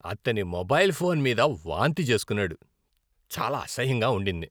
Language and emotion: Telugu, disgusted